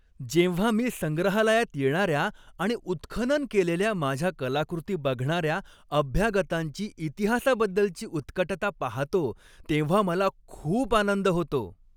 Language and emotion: Marathi, happy